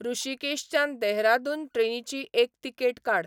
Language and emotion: Goan Konkani, neutral